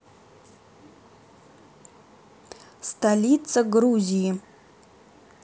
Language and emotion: Russian, neutral